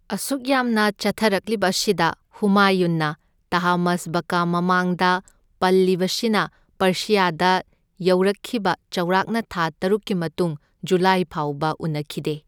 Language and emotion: Manipuri, neutral